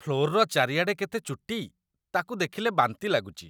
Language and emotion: Odia, disgusted